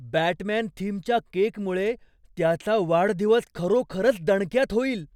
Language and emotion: Marathi, surprised